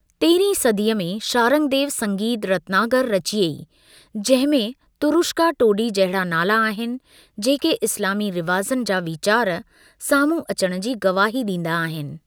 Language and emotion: Sindhi, neutral